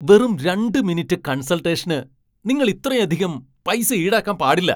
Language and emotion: Malayalam, angry